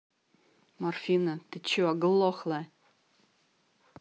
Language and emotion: Russian, angry